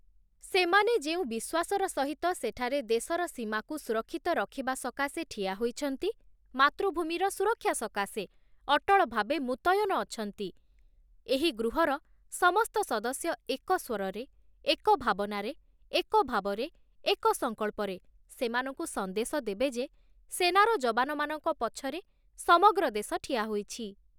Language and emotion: Odia, neutral